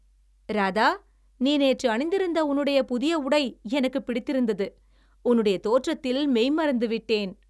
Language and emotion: Tamil, happy